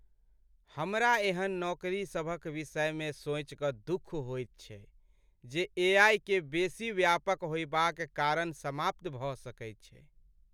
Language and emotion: Maithili, sad